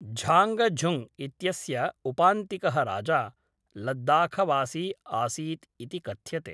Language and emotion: Sanskrit, neutral